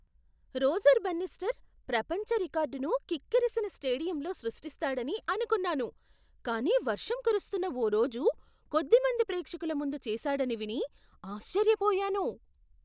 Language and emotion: Telugu, surprised